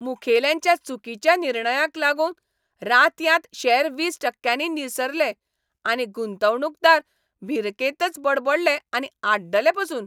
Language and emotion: Goan Konkani, angry